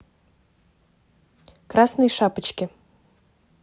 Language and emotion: Russian, neutral